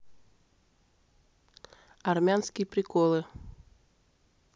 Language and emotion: Russian, neutral